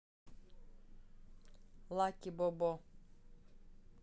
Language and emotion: Russian, neutral